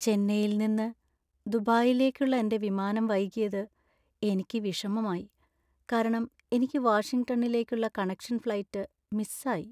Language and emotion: Malayalam, sad